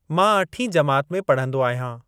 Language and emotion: Sindhi, neutral